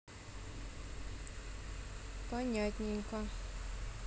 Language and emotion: Russian, neutral